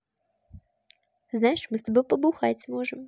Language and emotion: Russian, positive